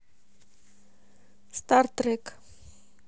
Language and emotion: Russian, neutral